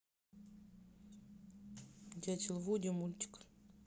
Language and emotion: Russian, neutral